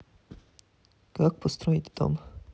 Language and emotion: Russian, neutral